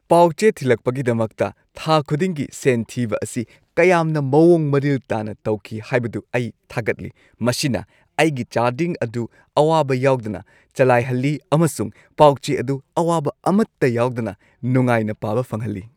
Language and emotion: Manipuri, happy